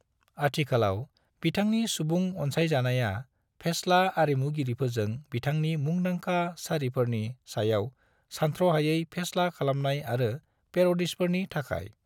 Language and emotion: Bodo, neutral